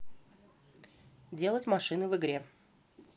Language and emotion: Russian, neutral